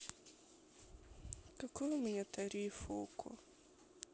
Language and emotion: Russian, sad